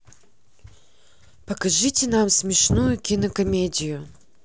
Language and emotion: Russian, neutral